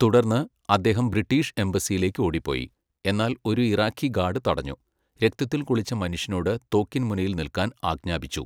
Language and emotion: Malayalam, neutral